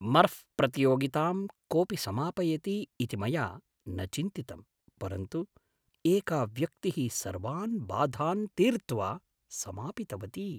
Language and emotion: Sanskrit, surprised